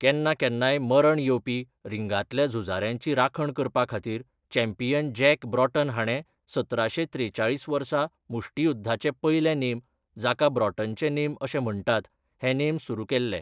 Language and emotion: Goan Konkani, neutral